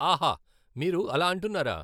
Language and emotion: Telugu, neutral